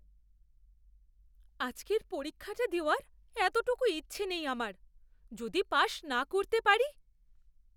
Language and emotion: Bengali, fearful